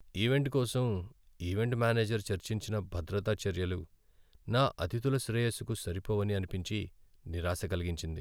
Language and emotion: Telugu, sad